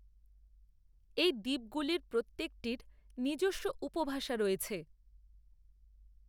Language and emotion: Bengali, neutral